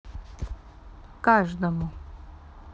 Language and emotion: Russian, neutral